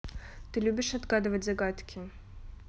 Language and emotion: Russian, neutral